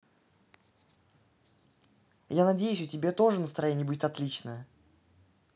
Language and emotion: Russian, neutral